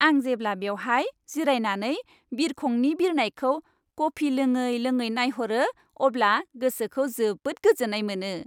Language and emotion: Bodo, happy